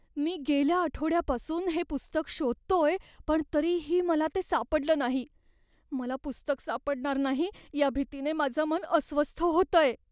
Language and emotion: Marathi, fearful